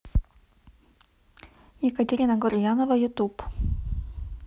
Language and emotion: Russian, neutral